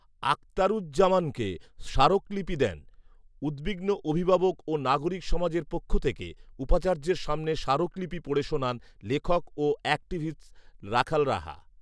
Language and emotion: Bengali, neutral